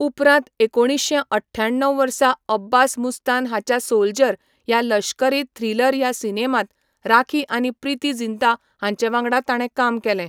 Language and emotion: Goan Konkani, neutral